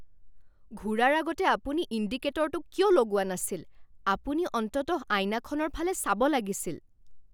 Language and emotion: Assamese, angry